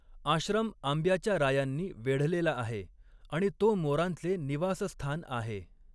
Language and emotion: Marathi, neutral